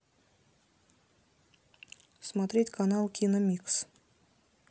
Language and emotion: Russian, neutral